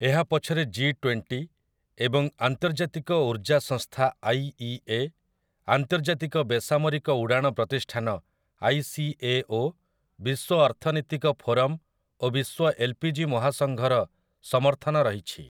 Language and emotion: Odia, neutral